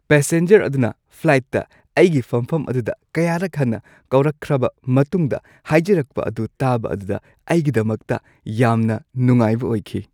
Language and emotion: Manipuri, happy